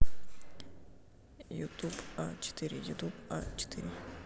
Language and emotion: Russian, neutral